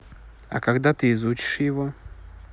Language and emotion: Russian, neutral